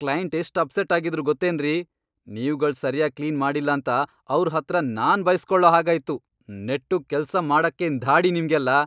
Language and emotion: Kannada, angry